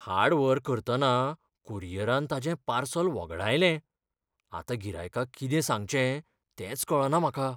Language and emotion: Goan Konkani, fearful